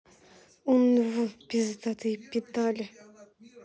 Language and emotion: Russian, angry